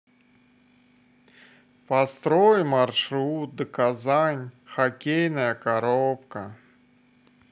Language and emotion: Russian, sad